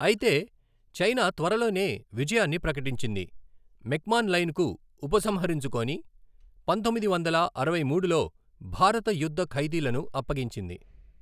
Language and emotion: Telugu, neutral